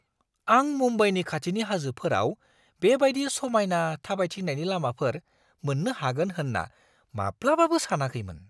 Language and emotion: Bodo, surprised